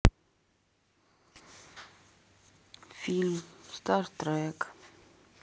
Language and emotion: Russian, sad